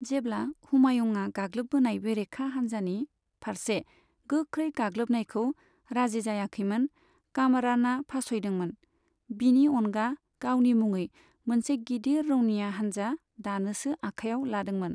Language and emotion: Bodo, neutral